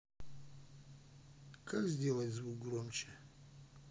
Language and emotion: Russian, neutral